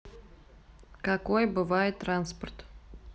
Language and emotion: Russian, neutral